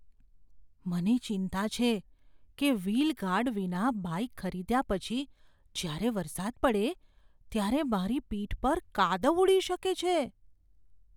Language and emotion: Gujarati, fearful